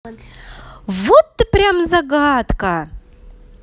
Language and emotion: Russian, positive